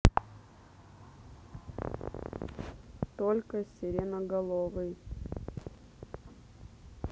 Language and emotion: Russian, neutral